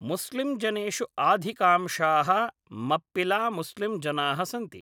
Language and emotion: Sanskrit, neutral